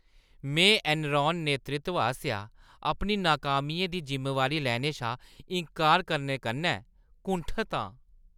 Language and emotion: Dogri, disgusted